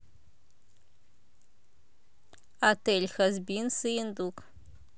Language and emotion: Russian, neutral